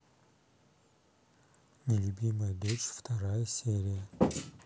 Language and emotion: Russian, neutral